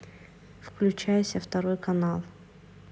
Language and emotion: Russian, neutral